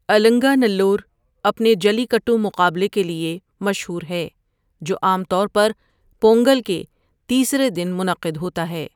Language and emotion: Urdu, neutral